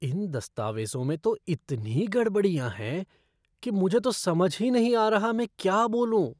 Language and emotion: Hindi, disgusted